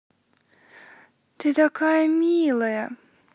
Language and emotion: Russian, positive